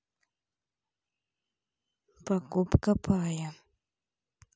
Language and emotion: Russian, neutral